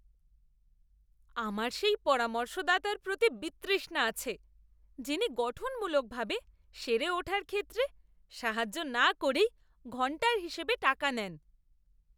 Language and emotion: Bengali, disgusted